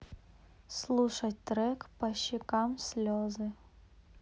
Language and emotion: Russian, neutral